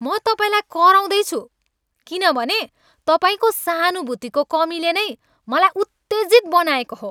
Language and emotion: Nepali, angry